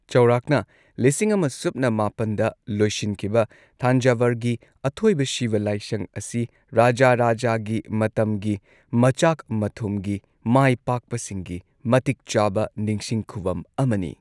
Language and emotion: Manipuri, neutral